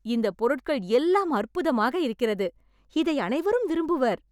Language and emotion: Tamil, surprised